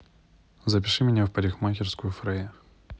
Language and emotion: Russian, neutral